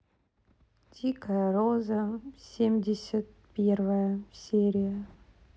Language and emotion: Russian, sad